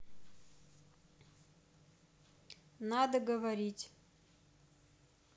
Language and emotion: Russian, neutral